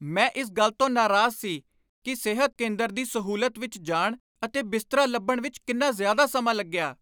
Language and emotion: Punjabi, angry